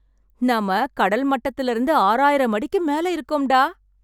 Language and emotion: Tamil, happy